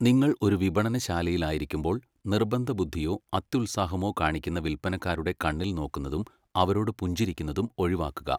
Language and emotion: Malayalam, neutral